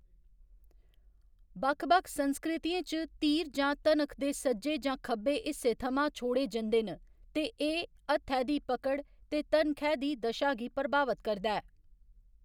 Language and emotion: Dogri, neutral